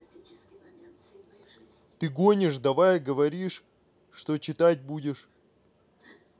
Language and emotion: Russian, angry